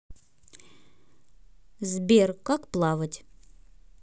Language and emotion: Russian, neutral